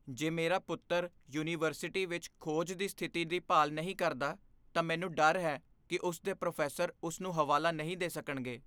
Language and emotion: Punjabi, fearful